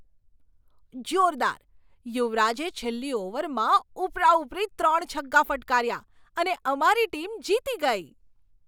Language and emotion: Gujarati, surprised